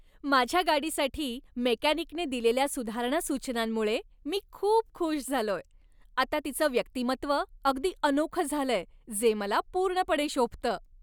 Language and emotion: Marathi, happy